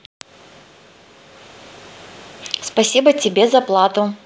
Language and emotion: Russian, positive